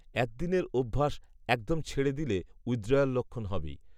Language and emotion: Bengali, neutral